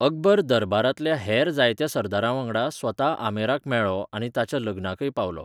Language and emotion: Goan Konkani, neutral